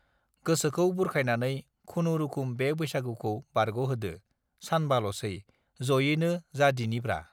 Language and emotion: Bodo, neutral